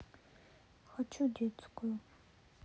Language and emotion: Russian, sad